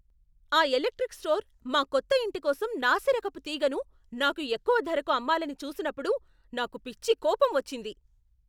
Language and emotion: Telugu, angry